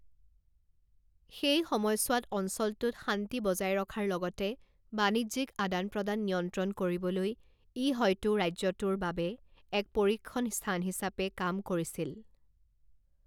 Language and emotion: Assamese, neutral